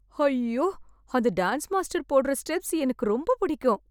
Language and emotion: Tamil, happy